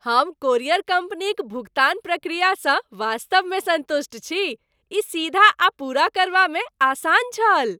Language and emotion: Maithili, happy